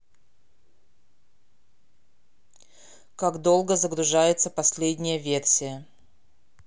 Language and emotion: Russian, neutral